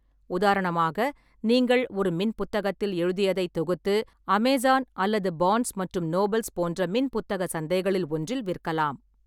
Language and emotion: Tamil, neutral